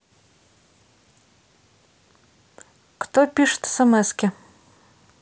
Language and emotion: Russian, neutral